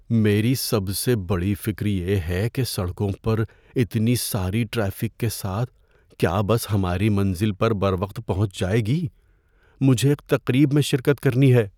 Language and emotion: Urdu, fearful